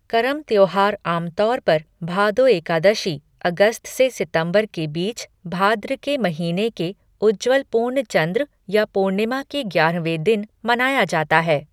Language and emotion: Hindi, neutral